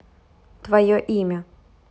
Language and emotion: Russian, neutral